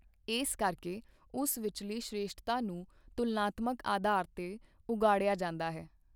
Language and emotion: Punjabi, neutral